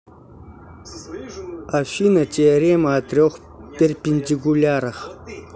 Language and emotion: Russian, neutral